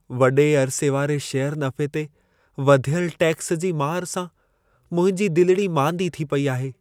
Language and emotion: Sindhi, sad